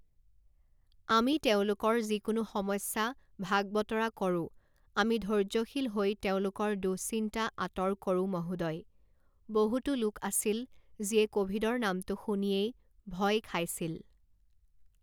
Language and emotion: Assamese, neutral